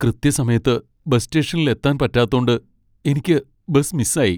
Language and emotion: Malayalam, sad